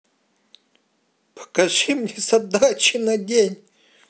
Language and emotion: Russian, sad